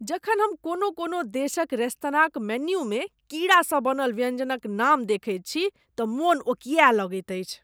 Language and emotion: Maithili, disgusted